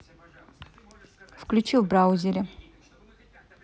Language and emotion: Russian, neutral